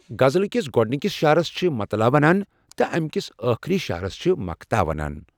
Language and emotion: Kashmiri, neutral